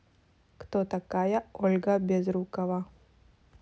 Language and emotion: Russian, neutral